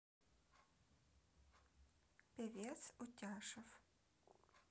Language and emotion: Russian, neutral